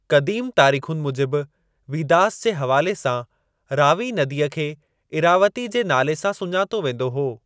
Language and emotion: Sindhi, neutral